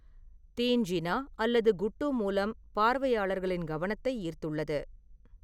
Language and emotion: Tamil, neutral